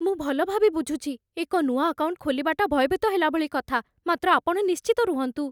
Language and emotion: Odia, fearful